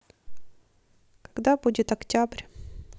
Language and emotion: Russian, neutral